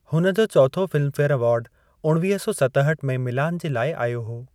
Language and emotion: Sindhi, neutral